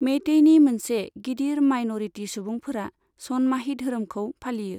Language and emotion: Bodo, neutral